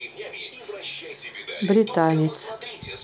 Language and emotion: Russian, neutral